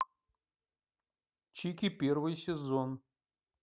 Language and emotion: Russian, neutral